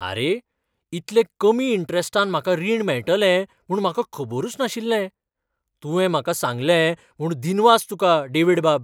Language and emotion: Goan Konkani, surprised